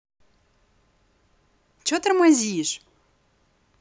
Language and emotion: Russian, angry